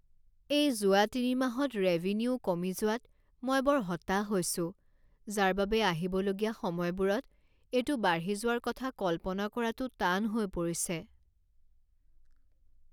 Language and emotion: Assamese, sad